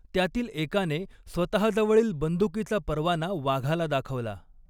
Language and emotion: Marathi, neutral